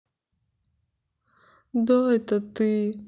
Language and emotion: Russian, sad